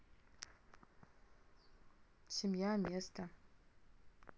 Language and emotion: Russian, neutral